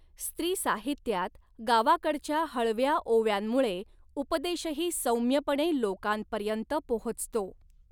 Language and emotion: Marathi, neutral